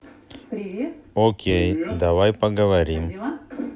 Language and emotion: Russian, neutral